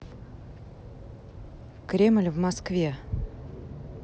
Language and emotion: Russian, neutral